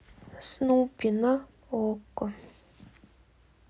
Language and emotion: Russian, sad